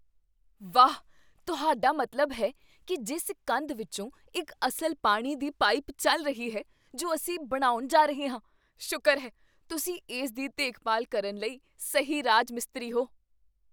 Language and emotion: Punjabi, surprised